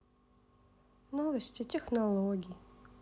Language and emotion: Russian, sad